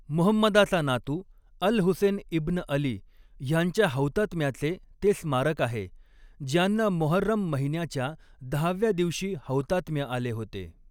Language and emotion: Marathi, neutral